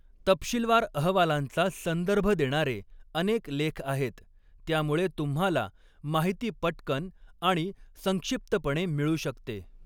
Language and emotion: Marathi, neutral